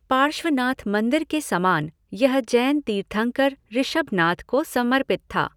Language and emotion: Hindi, neutral